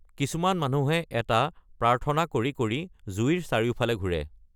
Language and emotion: Assamese, neutral